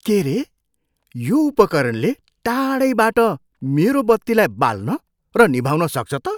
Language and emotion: Nepali, surprised